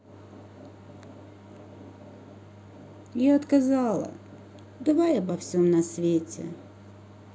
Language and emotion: Russian, sad